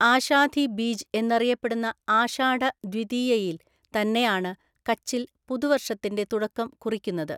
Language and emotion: Malayalam, neutral